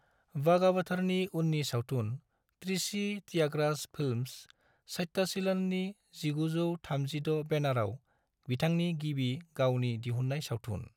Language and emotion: Bodo, neutral